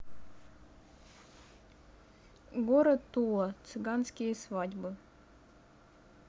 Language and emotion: Russian, neutral